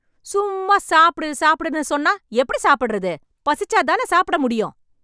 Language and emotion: Tamil, angry